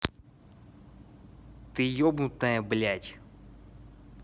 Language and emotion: Russian, angry